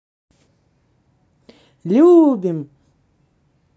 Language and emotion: Russian, positive